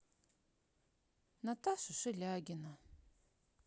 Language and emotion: Russian, sad